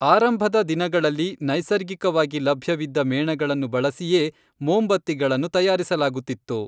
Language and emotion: Kannada, neutral